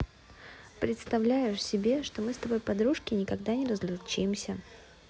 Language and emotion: Russian, neutral